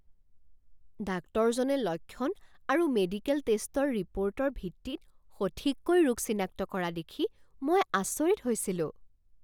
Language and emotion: Assamese, surprised